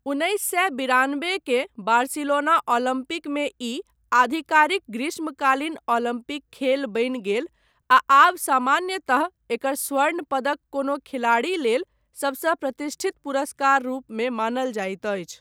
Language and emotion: Maithili, neutral